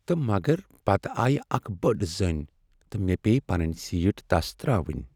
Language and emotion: Kashmiri, sad